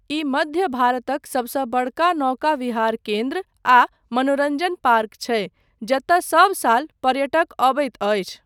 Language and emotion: Maithili, neutral